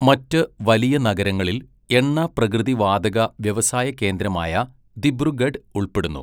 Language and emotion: Malayalam, neutral